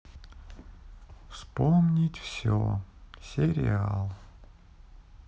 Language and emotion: Russian, sad